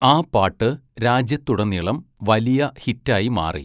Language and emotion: Malayalam, neutral